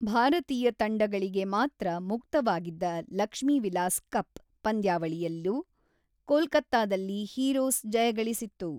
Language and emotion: Kannada, neutral